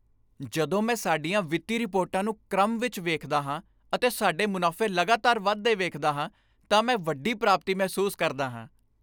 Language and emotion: Punjabi, happy